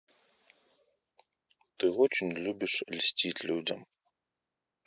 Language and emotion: Russian, neutral